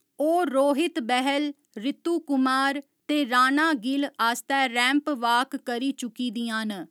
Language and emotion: Dogri, neutral